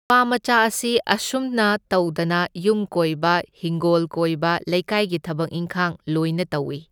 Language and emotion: Manipuri, neutral